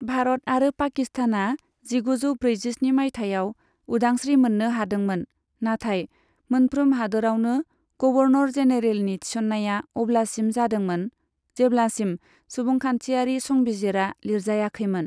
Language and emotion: Bodo, neutral